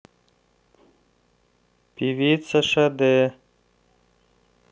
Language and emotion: Russian, neutral